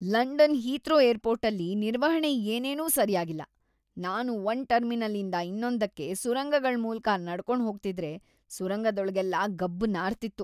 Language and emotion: Kannada, disgusted